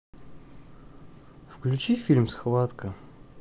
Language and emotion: Russian, neutral